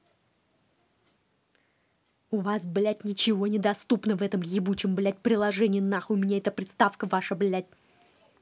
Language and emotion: Russian, angry